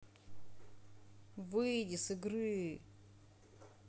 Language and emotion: Russian, angry